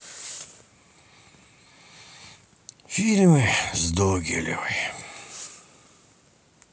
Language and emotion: Russian, sad